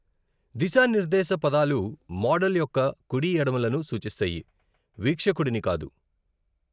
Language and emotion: Telugu, neutral